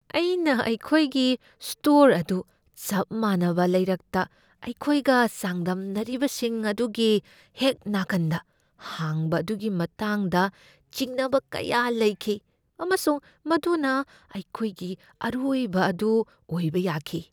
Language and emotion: Manipuri, fearful